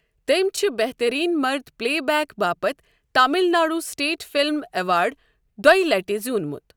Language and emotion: Kashmiri, neutral